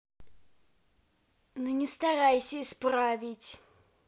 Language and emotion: Russian, angry